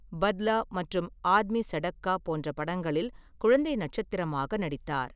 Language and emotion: Tamil, neutral